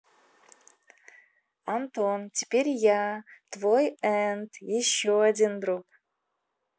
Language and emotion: Russian, positive